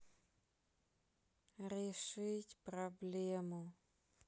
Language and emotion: Russian, sad